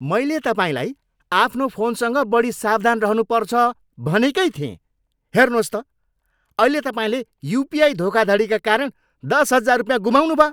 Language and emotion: Nepali, angry